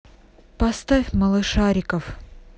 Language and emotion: Russian, neutral